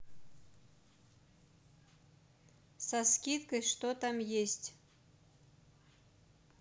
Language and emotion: Russian, neutral